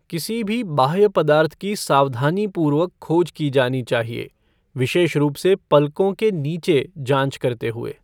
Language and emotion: Hindi, neutral